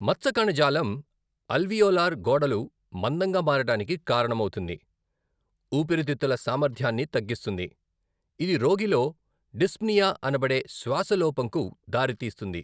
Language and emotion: Telugu, neutral